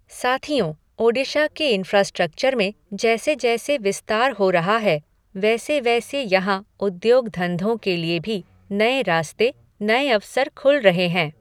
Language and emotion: Hindi, neutral